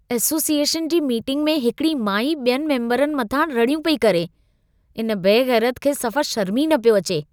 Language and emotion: Sindhi, disgusted